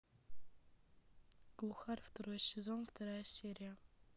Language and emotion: Russian, neutral